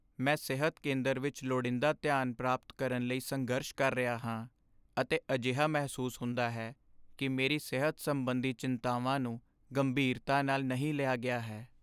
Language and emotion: Punjabi, sad